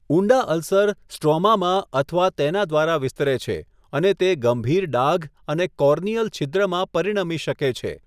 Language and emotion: Gujarati, neutral